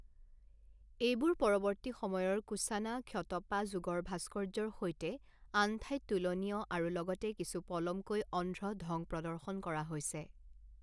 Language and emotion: Assamese, neutral